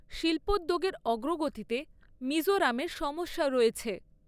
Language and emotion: Bengali, neutral